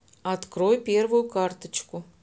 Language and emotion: Russian, neutral